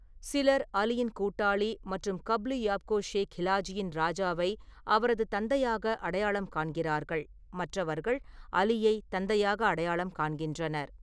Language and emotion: Tamil, neutral